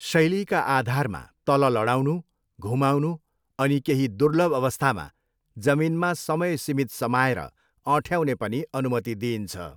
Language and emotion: Nepali, neutral